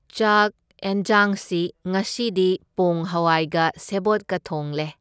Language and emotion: Manipuri, neutral